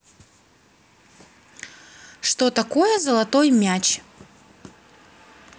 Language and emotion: Russian, neutral